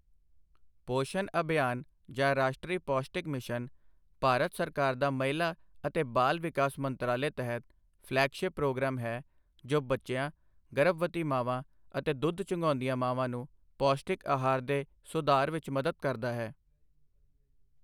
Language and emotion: Punjabi, neutral